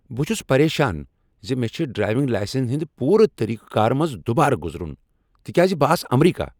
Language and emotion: Kashmiri, angry